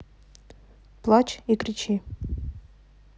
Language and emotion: Russian, neutral